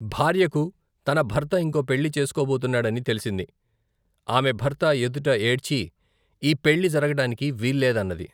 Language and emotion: Telugu, neutral